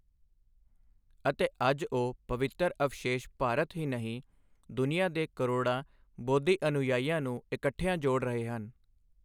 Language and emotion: Punjabi, neutral